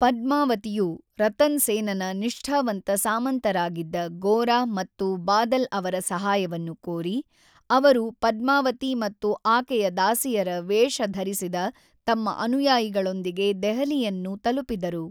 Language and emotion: Kannada, neutral